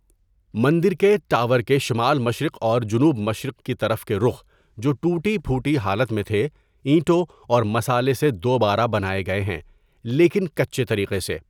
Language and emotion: Urdu, neutral